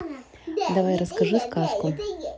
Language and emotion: Russian, neutral